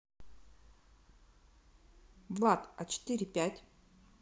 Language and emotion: Russian, neutral